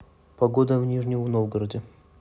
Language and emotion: Russian, neutral